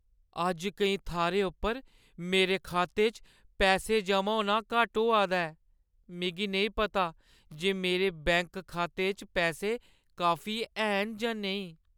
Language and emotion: Dogri, sad